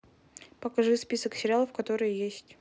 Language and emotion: Russian, neutral